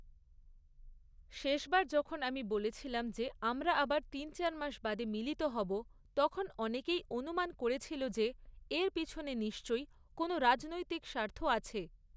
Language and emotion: Bengali, neutral